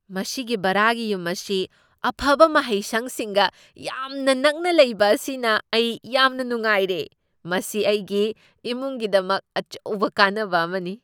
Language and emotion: Manipuri, surprised